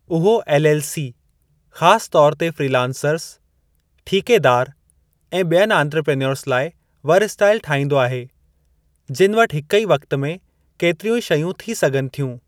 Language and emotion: Sindhi, neutral